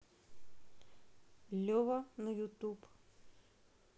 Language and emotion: Russian, neutral